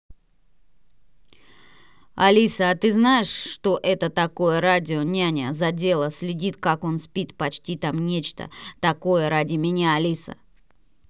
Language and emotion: Russian, angry